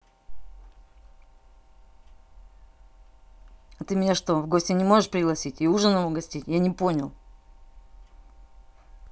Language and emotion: Russian, angry